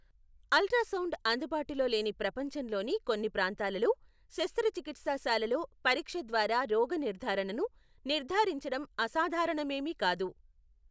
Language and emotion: Telugu, neutral